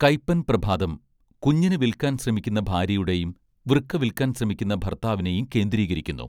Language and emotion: Malayalam, neutral